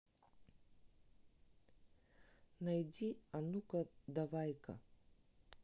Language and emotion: Russian, neutral